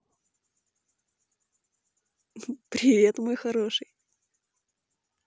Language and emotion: Russian, positive